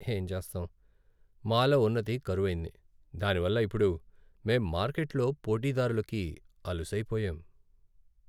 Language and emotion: Telugu, sad